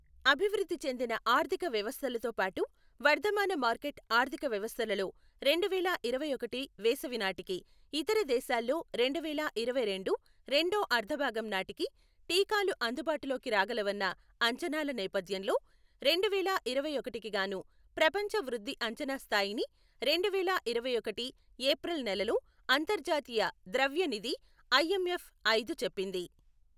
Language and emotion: Telugu, neutral